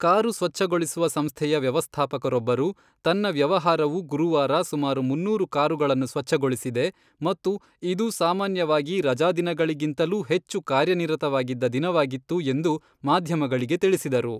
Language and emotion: Kannada, neutral